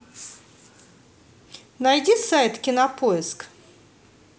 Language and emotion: Russian, positive